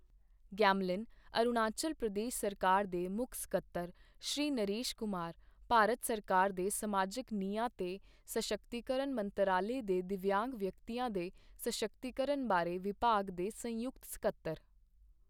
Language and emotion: Punjabi, neutral